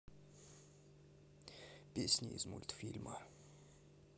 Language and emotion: Russian, neutral